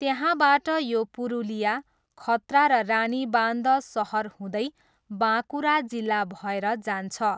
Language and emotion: Nepali, neutral